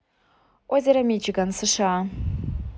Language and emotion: Russian, neutral